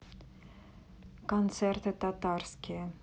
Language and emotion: Russian, neutral